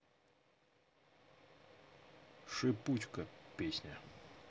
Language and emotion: Russian, neutral